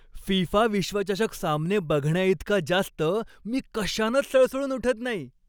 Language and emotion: Marathi, happy